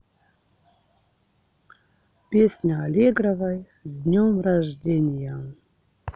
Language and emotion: Russian, neutral